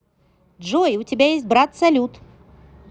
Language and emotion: Russian, positive